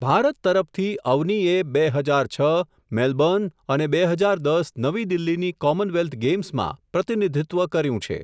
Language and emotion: Gujarati, neutral